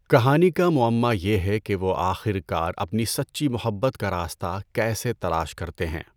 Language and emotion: Urdu, neutral